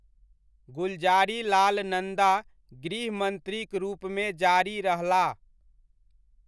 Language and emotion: Maithili, neutral